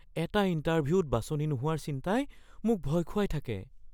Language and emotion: Assamese, fearful